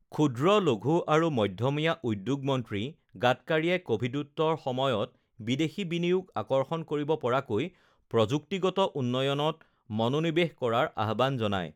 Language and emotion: Assamese, neutral